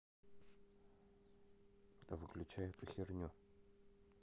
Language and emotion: Russian, neutral